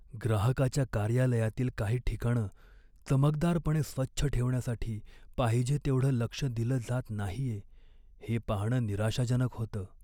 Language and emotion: Marathi, sad